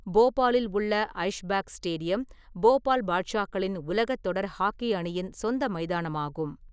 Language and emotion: Tamil, neutral